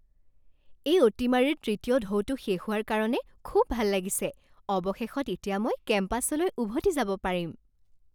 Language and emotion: Assamese, happy